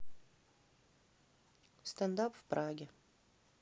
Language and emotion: Russian, neutral